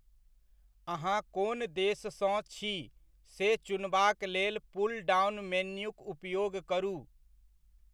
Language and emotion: Maithili, neutral